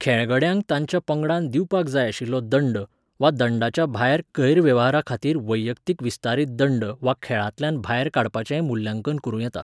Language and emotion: Goan Konkani, neutral